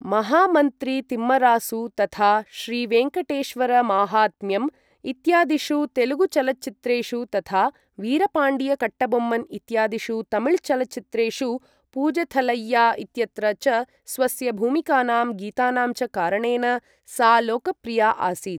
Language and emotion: Sanskrit, neutral